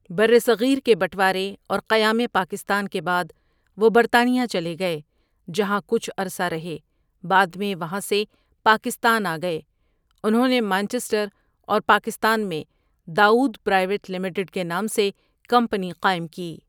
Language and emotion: Urdu, neutral